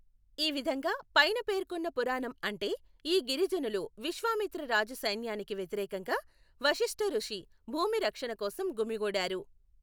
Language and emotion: Telugu, neutral